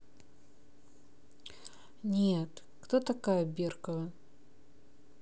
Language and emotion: Russian, sad